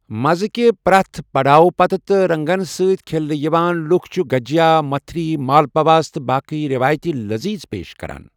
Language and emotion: Kashmiri, neutral